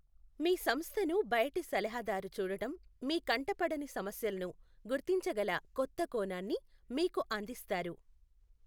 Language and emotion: Telugu, neutral